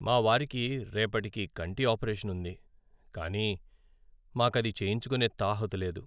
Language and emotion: Telugu, sad